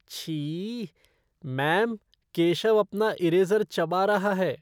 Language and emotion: Hindi, disgusted